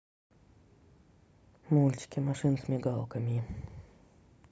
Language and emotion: Russian, neutral